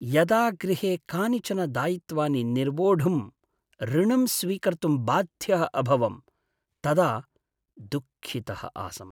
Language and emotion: Sanskrit, sad